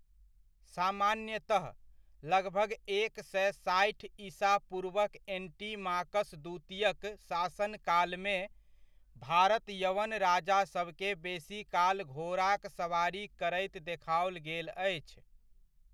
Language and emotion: Maithili, neutral